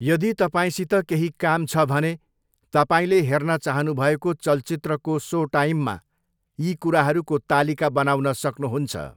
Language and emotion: Nepali, neutral